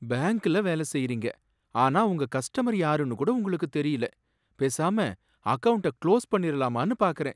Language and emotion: Tamil, sad